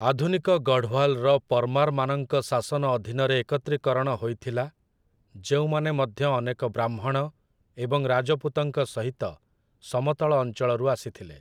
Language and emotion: Odia, neutral